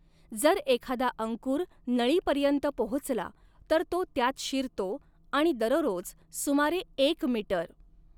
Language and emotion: Marathi, neutral